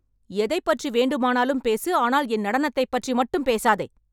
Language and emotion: Tamil, angry